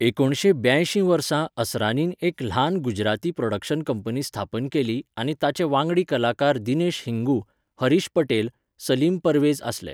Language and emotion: Goan Konkani, neutral